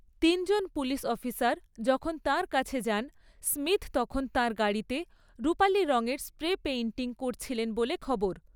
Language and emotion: Bengali, neutral